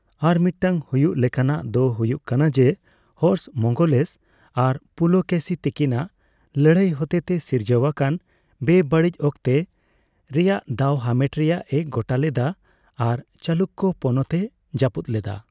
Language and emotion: Santali, neutral